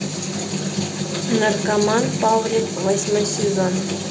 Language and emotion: Russian, neutral